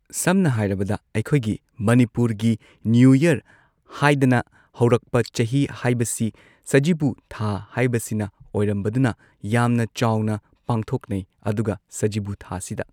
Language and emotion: Manipuri, neutral